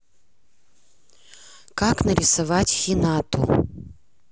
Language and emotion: Russian, neutral